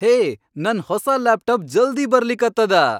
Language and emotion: Kannada, happy